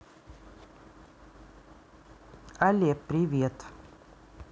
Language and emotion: Russian, neutral